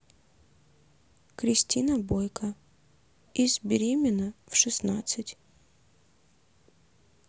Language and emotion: Russian, neutral